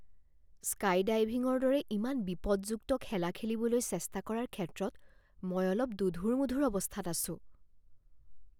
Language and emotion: Assamese, fearful